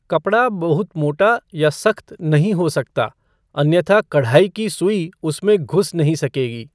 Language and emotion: Hindi, neutral